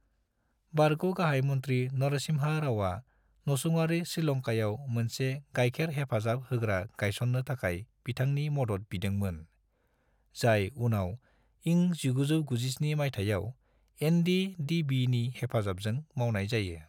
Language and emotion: Bodo, neutral